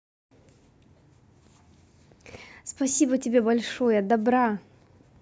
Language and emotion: Russian, positive